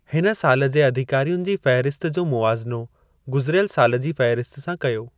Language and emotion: Sindhi, neutral